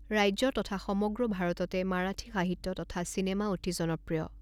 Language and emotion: Assamese, neutral